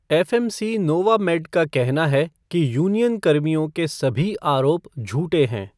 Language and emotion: Hindi, neutral